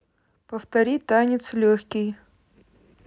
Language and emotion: Russian, neutral